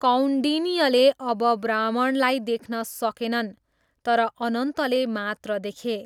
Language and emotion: Nepali, neutral